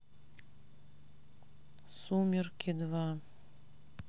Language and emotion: Russian, sad